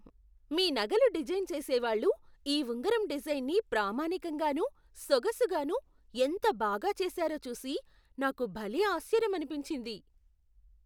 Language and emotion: Telugu, surprised